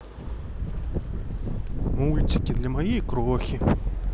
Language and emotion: Russian, neutral